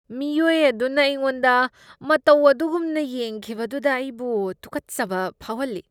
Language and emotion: Manipuri, disgusted